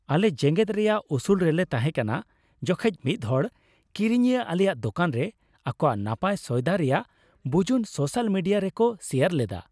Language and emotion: Santali, happy